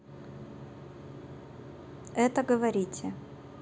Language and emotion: Russian, neutral